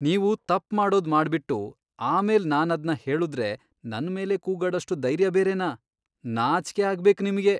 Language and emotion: Kannada, disgusted